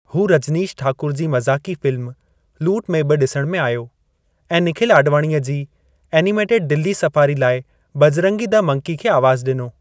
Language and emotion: Sindhi, neutral